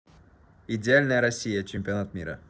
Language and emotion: Russian, neutral